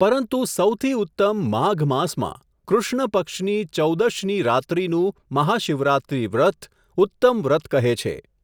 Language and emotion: Gujarati, neutral